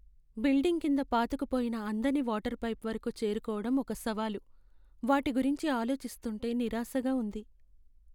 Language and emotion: Telugu, sad